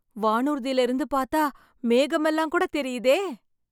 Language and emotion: Tamil, happy